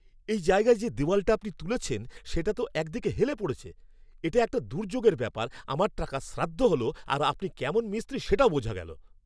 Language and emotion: Bengali, angry